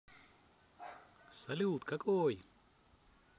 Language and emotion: Russian, positive